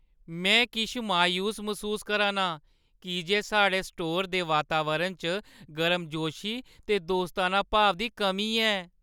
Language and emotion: Dogri, sad